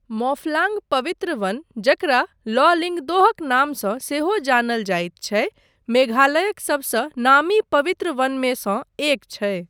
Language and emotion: Maithili, neutral